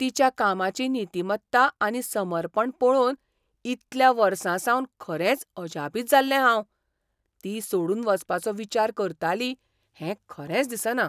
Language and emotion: Goan Konkani, surprised